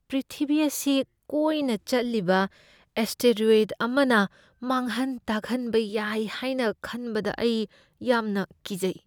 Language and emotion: Manipuri, fearful